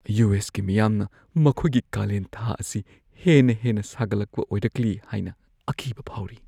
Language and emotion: Manipuri, fearful